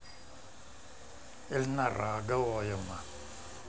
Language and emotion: Russian, neutral